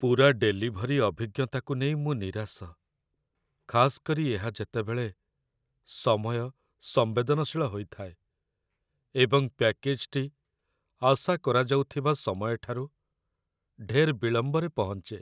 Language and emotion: Odia, sad